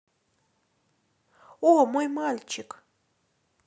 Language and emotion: Russian, positive